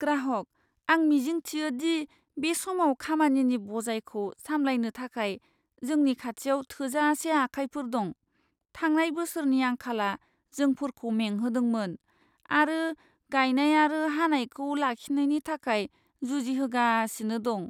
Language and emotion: Bodo, fearful